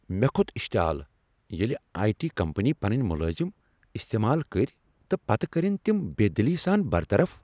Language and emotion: Kashmiri, angry